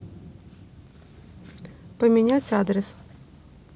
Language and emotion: Russian, neutral